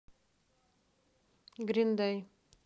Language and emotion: Russian, neutral